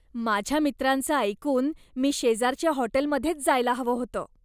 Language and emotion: Marathi, disgusted